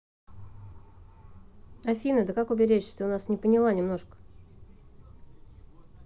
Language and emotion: Russian, neutral